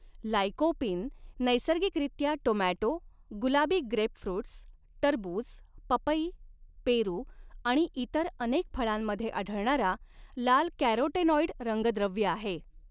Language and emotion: Marathi, neutral